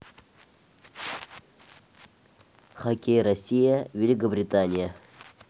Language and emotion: Russian, neutral